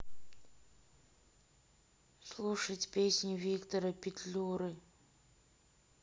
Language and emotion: Russian, sad